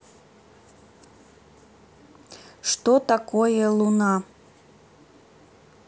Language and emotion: Russian, neutral